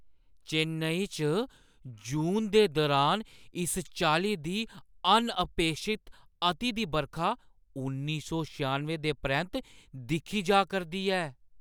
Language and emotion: Dogri, surprised